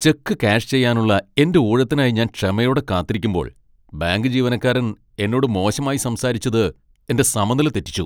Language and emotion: Malayalam, angry